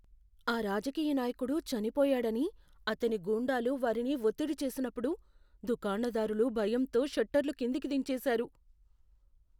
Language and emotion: Telugu, fearful